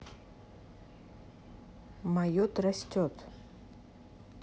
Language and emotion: Russian, neutral